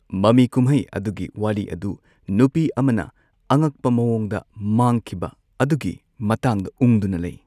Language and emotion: Manipuri, neutral